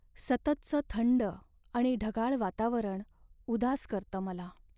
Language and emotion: Marathi, sad